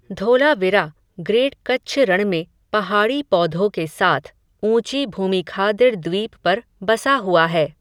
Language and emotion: Hindi, neutral